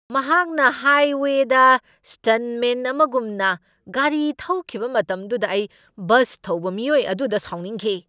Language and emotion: Manipuri, angry